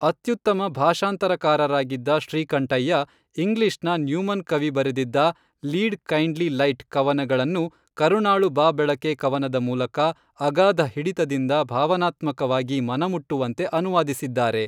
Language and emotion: Kannada, neutral